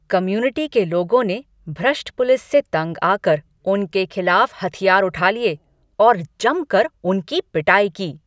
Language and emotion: Hindi, angry